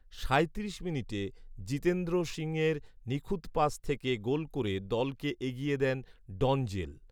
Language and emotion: Bengali, neutral